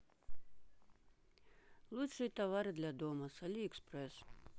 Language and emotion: Russian, neutral